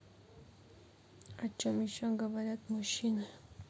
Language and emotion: Russian, neutral